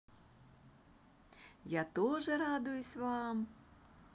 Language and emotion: Russian, positive